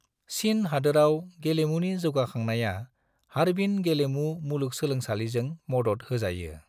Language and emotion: Bodo, neutral